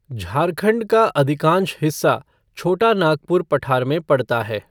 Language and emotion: Hindi, neutral